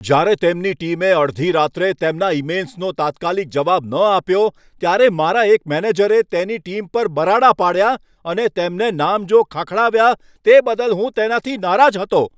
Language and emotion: Gujarati, angry